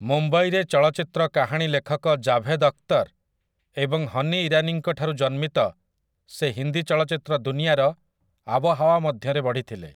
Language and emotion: Odia, neutral